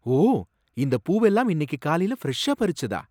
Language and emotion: Tamil, surprised